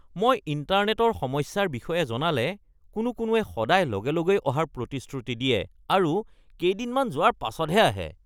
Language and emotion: Assamese, disgusted